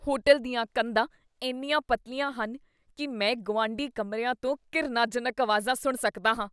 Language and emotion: Punjabi, disgusted